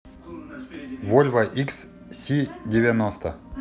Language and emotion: Russian, neutral